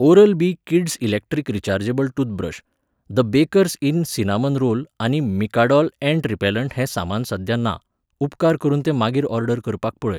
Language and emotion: Goan Konkani, neutral